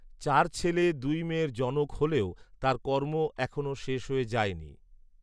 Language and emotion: Bengali, neutral